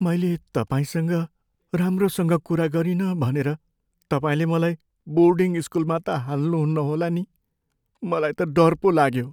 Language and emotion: Nepali, fearful